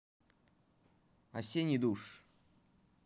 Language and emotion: Russian, neutral